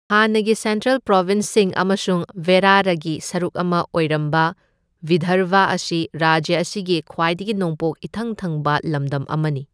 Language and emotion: Manipuri, neutral